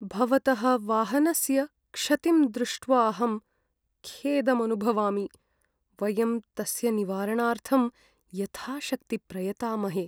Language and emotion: Sanskrit, sad